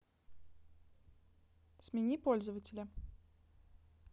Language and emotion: Russian, neutral